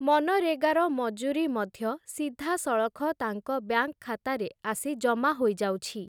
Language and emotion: Odia, neutral